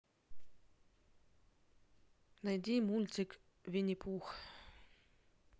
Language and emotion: Russian, neutral